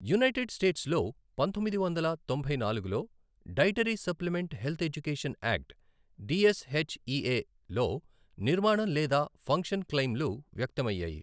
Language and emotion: Telugu, neutral